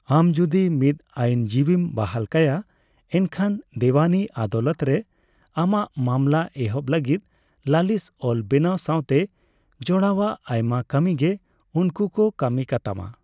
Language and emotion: Santali, neutral